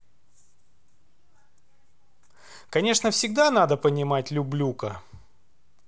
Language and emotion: Russian, neutral